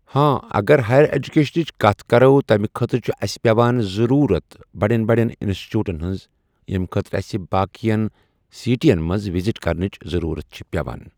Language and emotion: Kashmiri, neutral